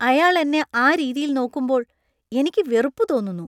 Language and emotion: Malayalam, disgusted